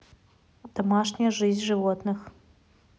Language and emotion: Russian, neutral